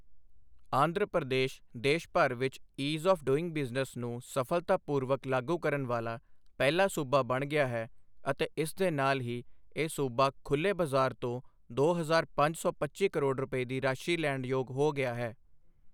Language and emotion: Punjabi, neutral